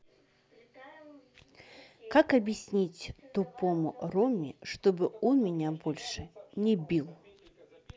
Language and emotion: Russian, neutral